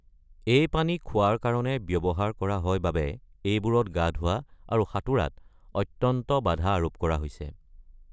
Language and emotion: Assamese, neutral